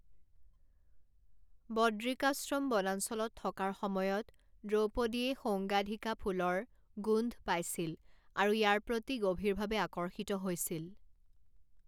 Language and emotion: Assamese, neutral